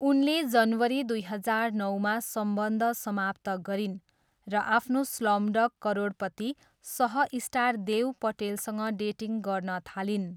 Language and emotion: Nepali, neutral